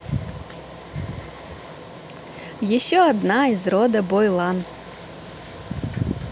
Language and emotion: Russian, positive